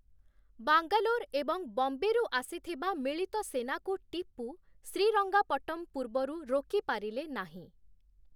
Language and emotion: Odia, neutral